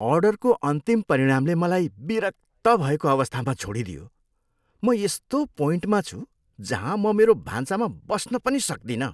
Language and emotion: Nepali, disgusted